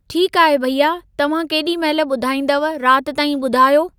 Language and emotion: Sindhi, neutral